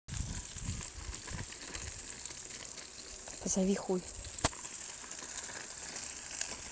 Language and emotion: Russian, neutral